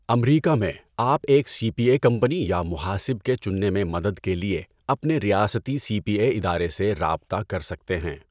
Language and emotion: Urdu, neutral